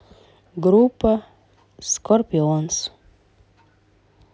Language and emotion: Russian, neutral